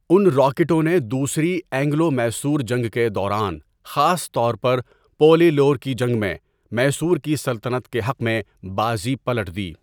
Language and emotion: Urdu, neutral